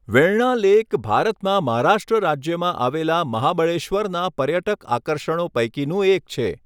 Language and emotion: Gujarati, neutral